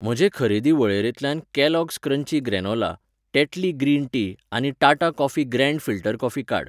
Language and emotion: Goan Konkani, neutral